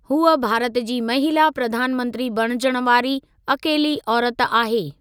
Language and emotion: Sindhi, neutral